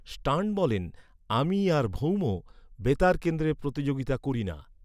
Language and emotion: Bengali, neutral